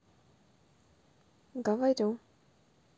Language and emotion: Russian, neutral